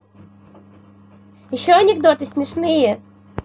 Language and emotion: Russian, positive